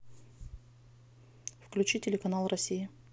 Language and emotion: Russian, neutral